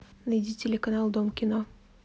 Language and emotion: Russian, neutral